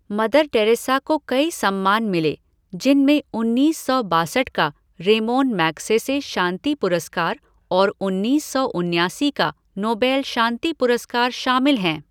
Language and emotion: Hindi, neutral